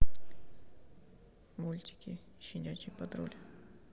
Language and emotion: Russian, neutral